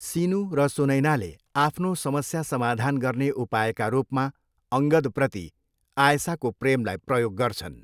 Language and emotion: Nepali, neutral